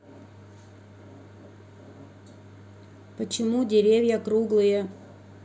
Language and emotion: Russian, neutral